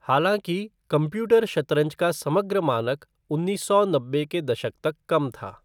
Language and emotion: Hindi, neutral